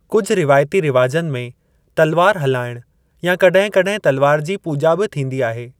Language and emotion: Sindhi, neutral